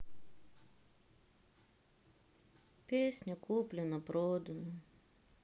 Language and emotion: Russian, sad